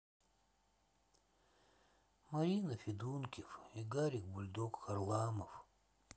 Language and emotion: Russian, sad